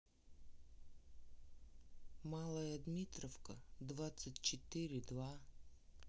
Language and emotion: Russian, neutral